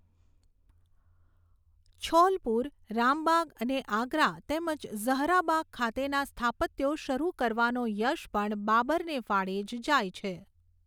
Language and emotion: Gujarati, neutral